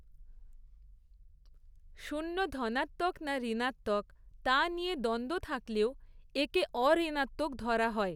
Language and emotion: Bengali, neutral